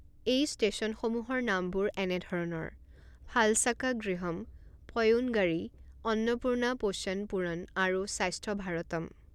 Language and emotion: Assamese, neutral